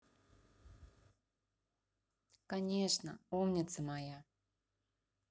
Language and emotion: Russian, positive